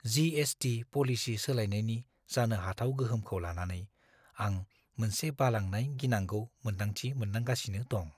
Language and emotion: Bodo, fearful